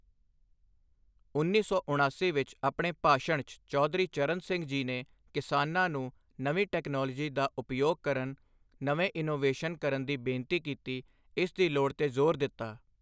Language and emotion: Punjabi, neutral